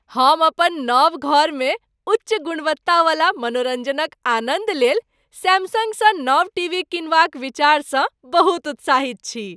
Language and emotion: Maithili, happy